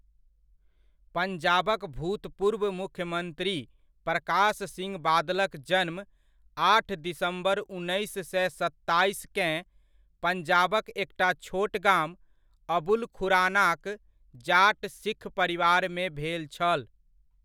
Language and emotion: Maithili, neutral